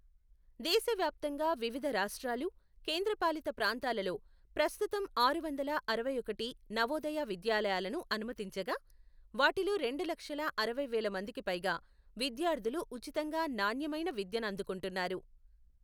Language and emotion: Telugu, neutral